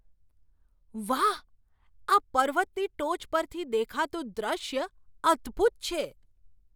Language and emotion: Gujarati, surprised